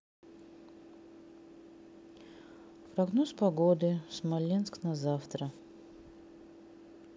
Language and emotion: Russian, neutral